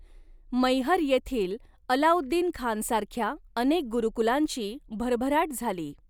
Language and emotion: Marathi, neutral